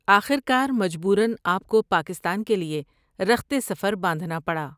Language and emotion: Urdu, neutral